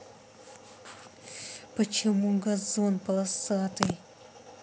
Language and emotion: Russian, angry